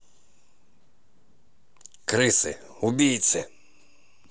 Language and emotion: Russian, angry